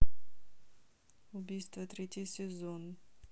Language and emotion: Russian, neutral